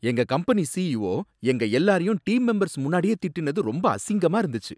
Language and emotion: Tamil, angry